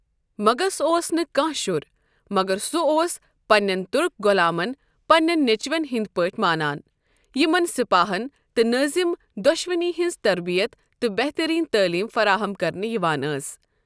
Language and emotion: Kashmiri, neutral